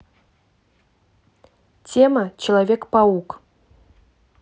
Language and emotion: Russian, neutral